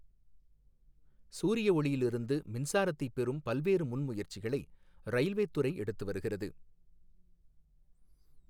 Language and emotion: Tamil, neutral